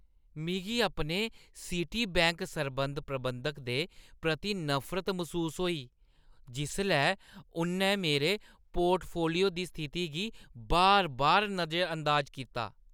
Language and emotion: Dogri, disgusted